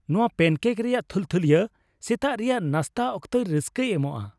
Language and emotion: Santali, happy